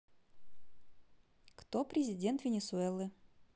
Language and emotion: Russian, positive